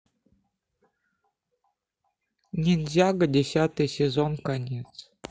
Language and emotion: Russian, neutral